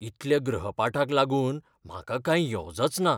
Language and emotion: Goan Konkani, fearful